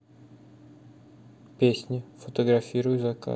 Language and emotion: Russian, neutral